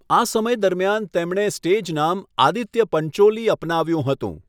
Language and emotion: Gujarati, neutral